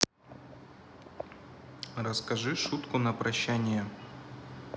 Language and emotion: Russian, neutral